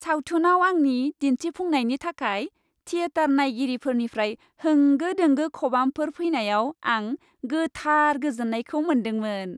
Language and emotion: Bodo, happy